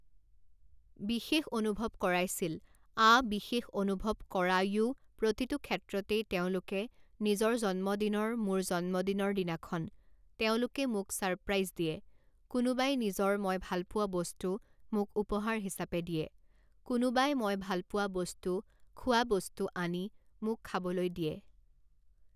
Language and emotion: Assamese, neutral